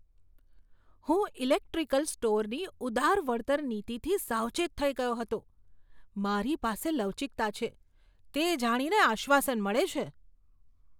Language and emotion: Gujarati, surprised